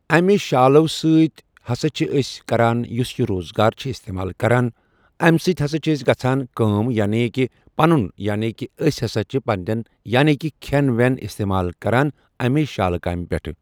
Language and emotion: Kashmiri, neutral